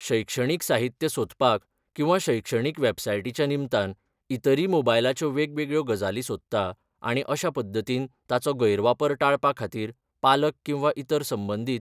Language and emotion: Goan Konkani, neutral